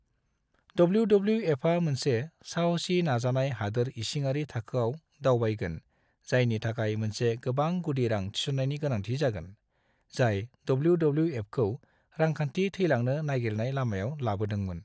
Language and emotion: Bodo, neutral